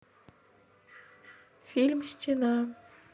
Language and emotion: Russian, neutral